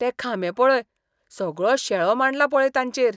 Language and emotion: Goan Konkani, disgusted